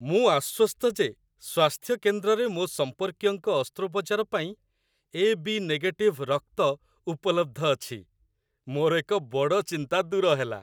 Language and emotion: Odia, happy